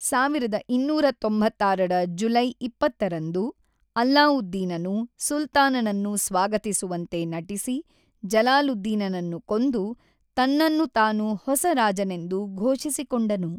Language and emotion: Kannada, neutral